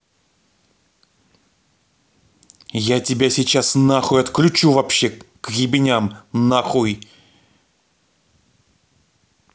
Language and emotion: Russian, angry